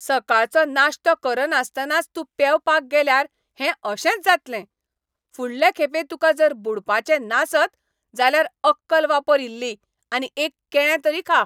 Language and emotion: Goan Konkani, angry